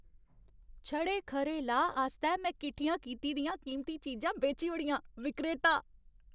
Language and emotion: Dogri, happy